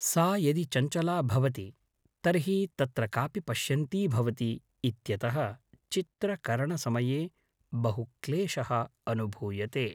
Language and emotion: Sanskrit, neutral